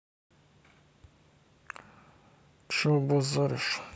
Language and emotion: Russian, neutral